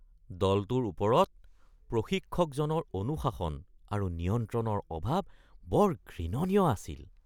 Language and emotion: Assamese, disgusted